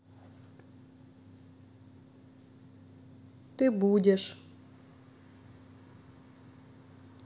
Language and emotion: Russian, neutral